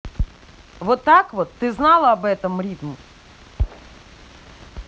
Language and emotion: Russian, angry